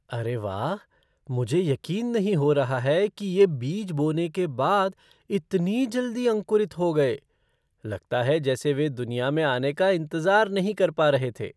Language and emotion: Hindi, surprised